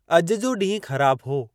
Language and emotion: Sindhi, neutral